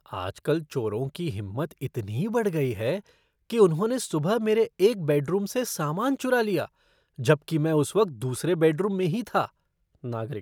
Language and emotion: Hindi, disgusted